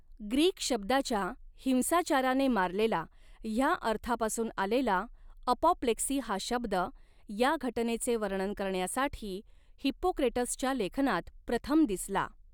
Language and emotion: Marathi, neutral